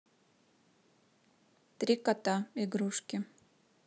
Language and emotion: Russian, neutral